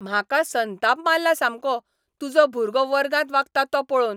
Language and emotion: Goan Konkani, angry